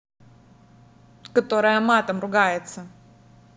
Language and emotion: Russian, angry